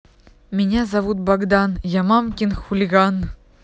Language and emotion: Russian, positive